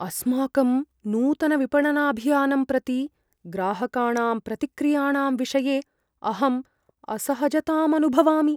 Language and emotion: Sanskrit, fearful